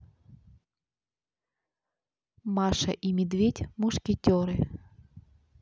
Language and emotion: Russian, neutral